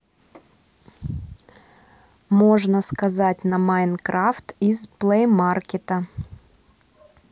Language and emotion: Russian, neutral